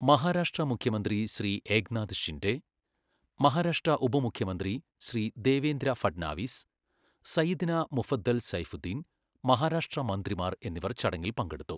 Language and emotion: Malayalam, neutral